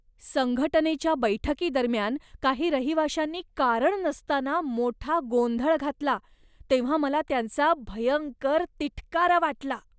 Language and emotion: Marathi, disgusted